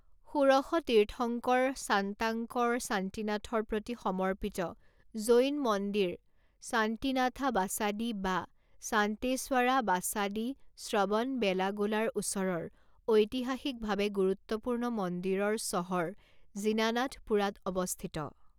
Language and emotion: Assamese, neutral